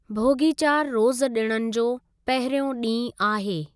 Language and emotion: Sindhi, neutral